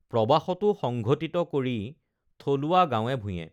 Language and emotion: Assamese, neutral